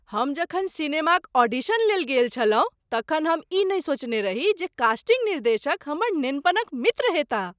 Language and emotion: Maithili, surprised